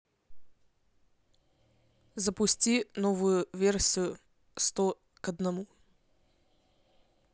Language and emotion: Russian, neutral